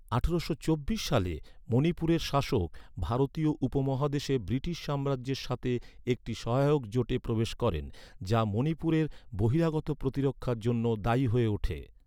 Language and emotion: Bengali, neutral